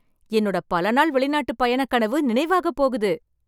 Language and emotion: Tamil, happy